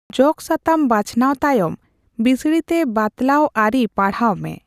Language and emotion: Santali, neutral